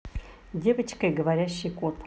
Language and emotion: Russian, positive